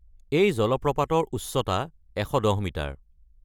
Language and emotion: Assamese, neutral